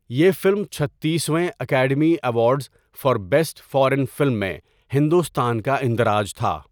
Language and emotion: Urdu, neutral